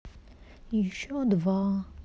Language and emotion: Russian, sad